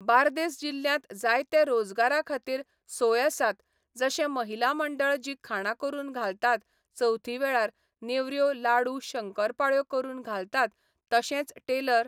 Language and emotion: Goan Konkani, neutral